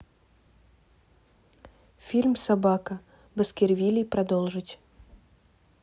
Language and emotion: Russian, neutral